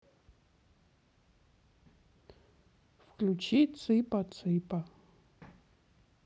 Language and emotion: Russian, sad